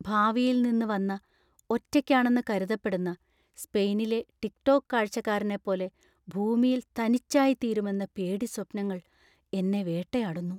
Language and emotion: Malayalam, fearful